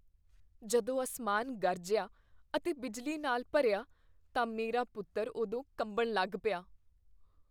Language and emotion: Punjabi, fearful